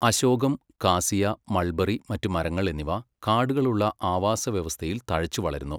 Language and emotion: Malayalam, neutral